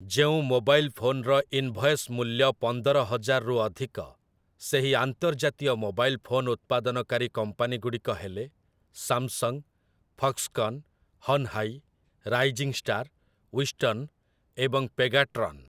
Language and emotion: Odia, neutral